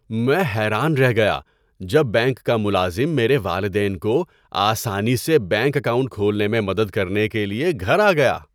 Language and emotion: Urdu, surprised